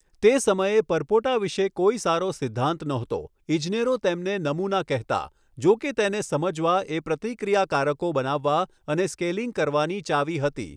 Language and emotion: Gujarati, neutral